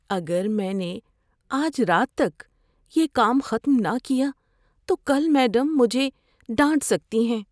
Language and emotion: Urdu, fearful